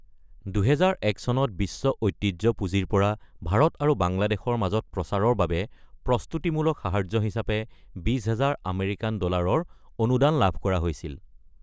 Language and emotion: Assamese, neutral